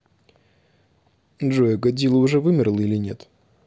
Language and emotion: Russian, neutral